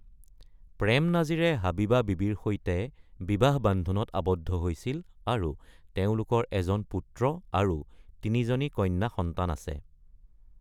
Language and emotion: Assamese, neutral